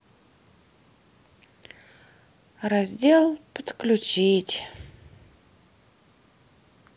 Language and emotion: Russian, sad